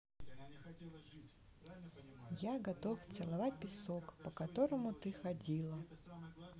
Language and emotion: Russian, neutral